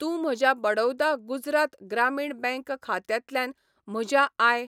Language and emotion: Goan Konkani, neutral